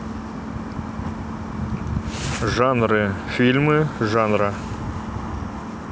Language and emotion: Russian, neutral